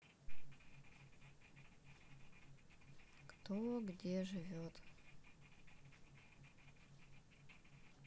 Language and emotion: Russian, sad